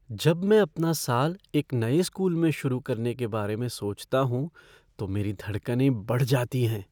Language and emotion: Hindi, fearful